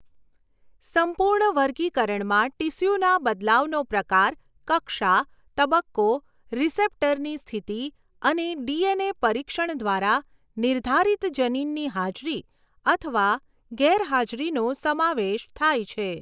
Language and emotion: Gujarati, neutral